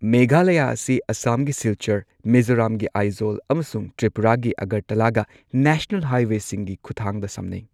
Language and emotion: Manipuri, neutral